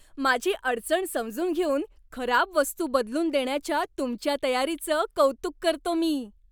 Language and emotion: Marathi, happy